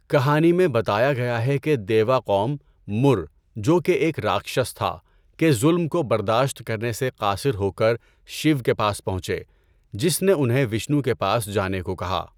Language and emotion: Urdu, neutral